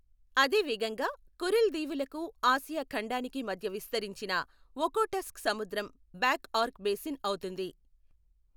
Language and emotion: Telugu, neutral